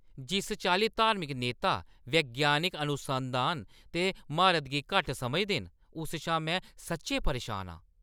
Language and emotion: Dogri, angry